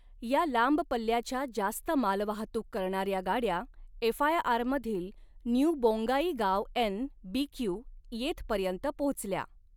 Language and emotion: Marathi, neutral